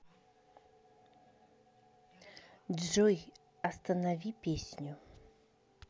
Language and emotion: Russian, neutral